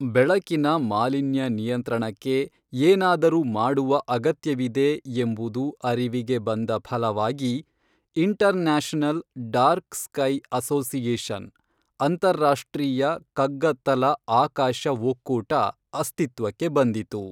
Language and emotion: Kannada, neutral